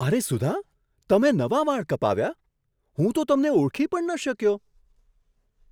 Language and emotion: Gujarati, surprised